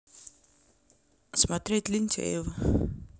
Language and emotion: Russian, neutral